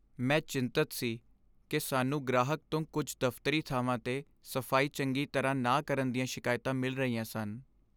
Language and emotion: Punjabi, sad